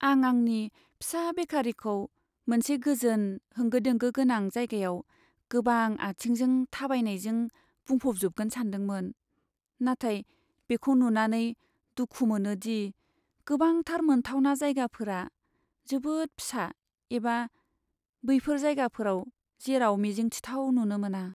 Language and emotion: Bodo, sad